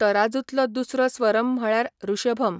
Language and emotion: Goan Konkani, neutral